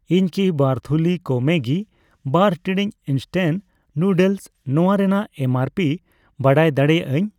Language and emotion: Santali, neutral